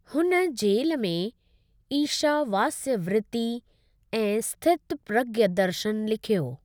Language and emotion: Sindhi, neutral